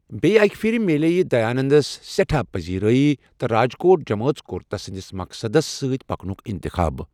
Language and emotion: Kashmiri, neutral